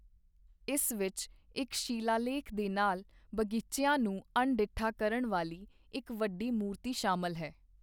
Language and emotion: Punjabi, neutral